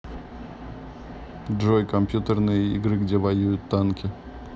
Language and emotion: Russian, neutral